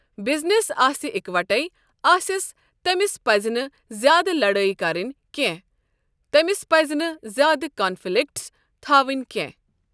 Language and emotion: Kashmiri, neutral